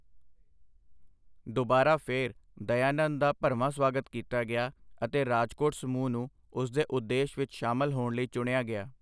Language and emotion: Punjabi, neutral